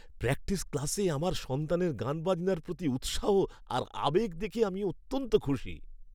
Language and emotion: Bengali, happy